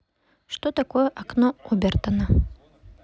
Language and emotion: Russian, neutral